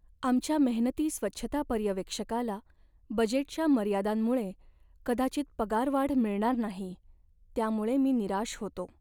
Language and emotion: Marathi, sad